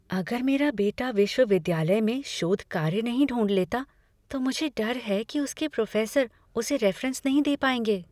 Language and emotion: Hindi, fearful